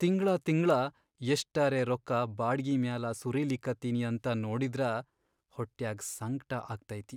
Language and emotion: Kannada, sad